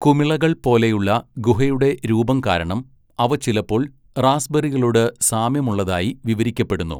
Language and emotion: Malayalam, neutral